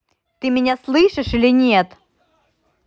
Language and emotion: Russian, angry